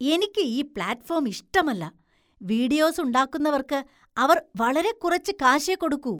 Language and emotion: Malayalam, disgusted